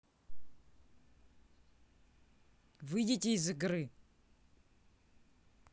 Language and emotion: Russian, angry